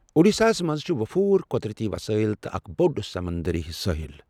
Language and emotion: Kashmiri, neutral